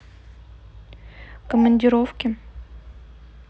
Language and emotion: Russian, neutral